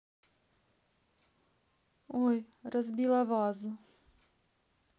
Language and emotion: Russian, neutral